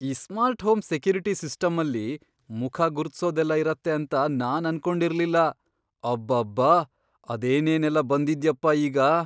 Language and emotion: Kannada, surprised